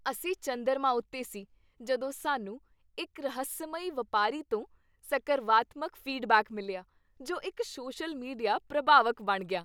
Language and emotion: Punjabi, happy